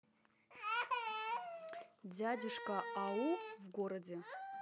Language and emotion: Russian, neutral